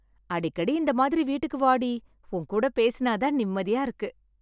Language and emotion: Tamil, happy